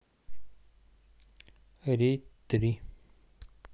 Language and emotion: Russian, neutral